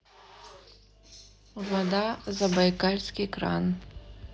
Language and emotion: Russian, neutral